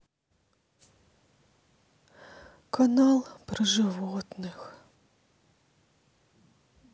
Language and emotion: Russian, sad